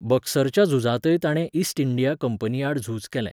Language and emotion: Goan Konkani, neutral